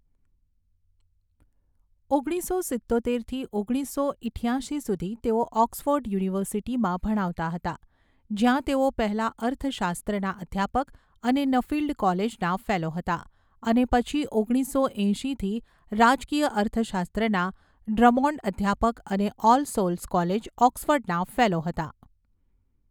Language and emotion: Gujarati, neutral